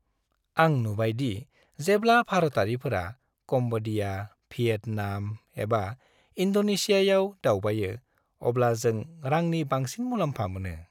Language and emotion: Bodo, happy